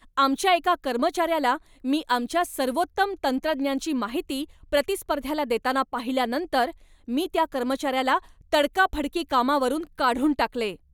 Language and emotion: Marathi, angry